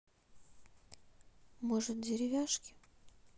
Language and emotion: Russian, sad